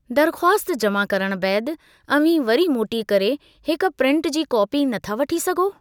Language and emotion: Sindhi, neutral